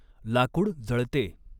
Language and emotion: Marathi, neutral